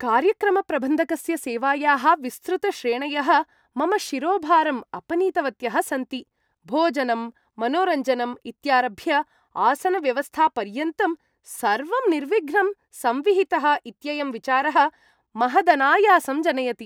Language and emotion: Sanskrit, happy